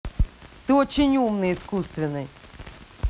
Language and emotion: Russian, angry